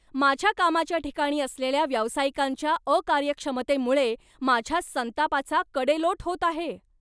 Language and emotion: Marathi, angry